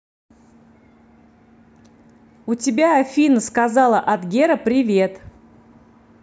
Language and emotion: Russian, positive